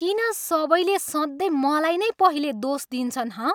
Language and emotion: Nepali, angry